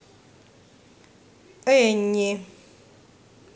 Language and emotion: Russian, neutral